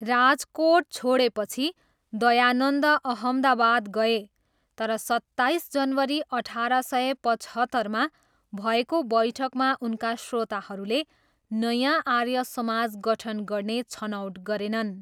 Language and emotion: Nepali, neutral